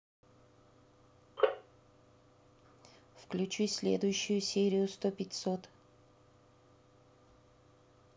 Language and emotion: Russian, neutral